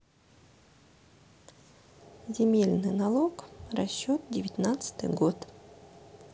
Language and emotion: Russian, neutral